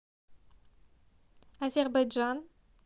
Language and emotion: Russian, neutral